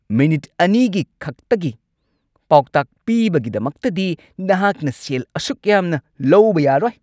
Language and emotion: Manipuri, angry